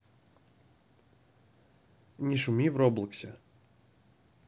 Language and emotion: Russian, neutral